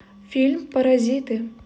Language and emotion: Russian, neutral